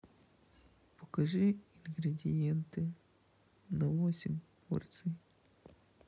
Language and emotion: Russian, sad